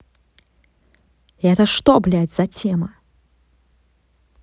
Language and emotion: Russian, angry